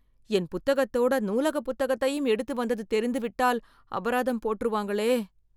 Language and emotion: Tamil, fearful